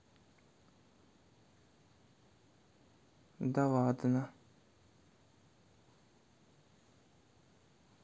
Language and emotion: Russian, neutral